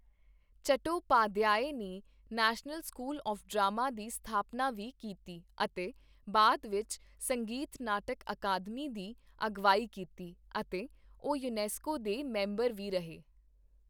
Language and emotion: Punjabi, neutral